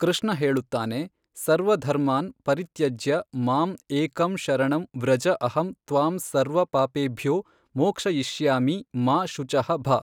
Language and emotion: Kannada, neutral